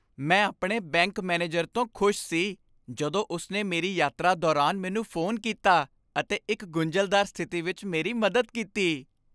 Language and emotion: Punjabi, happy